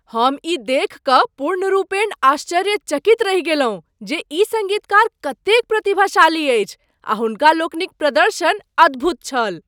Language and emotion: Maithili, surprised